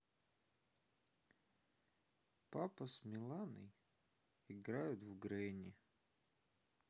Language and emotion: Russian, sad